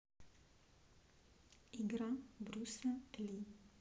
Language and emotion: Russian, neutral